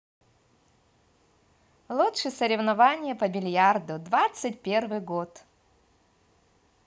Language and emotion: Russian, positive